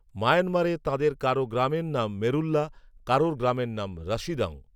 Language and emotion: Bengali, neutral